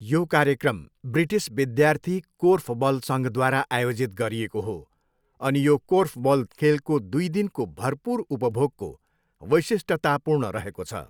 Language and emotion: Nepali, neutral